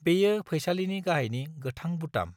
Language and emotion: Bodo, neutral